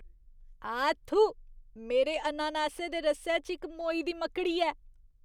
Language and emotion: Dogri, disgusted